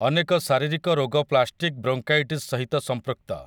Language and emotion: Odia, neutral